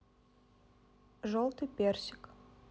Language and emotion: Russian, neutral